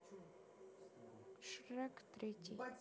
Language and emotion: Russian, neutral